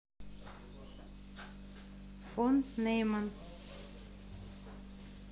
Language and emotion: Russian, neutral